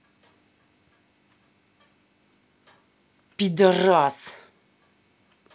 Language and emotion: Russian, angry